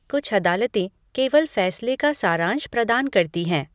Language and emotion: Hindi, neutral